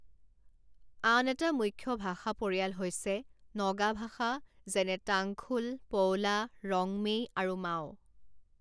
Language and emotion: Assamese, neutral